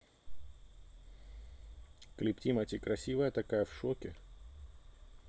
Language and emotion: Russian, neutral